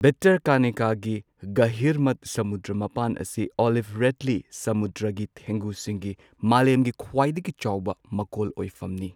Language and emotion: Manipuri, neutral